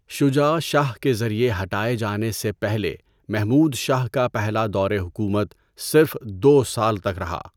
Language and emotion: Urdu, neutral